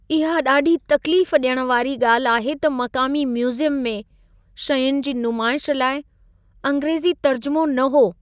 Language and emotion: Sindhi, sad